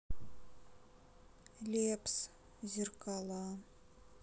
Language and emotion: Russian, sad